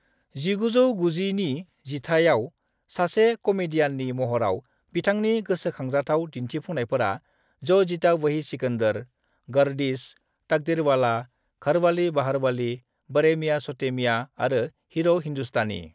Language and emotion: Bodo, neutral